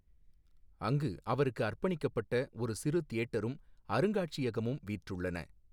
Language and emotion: Tamil, neutral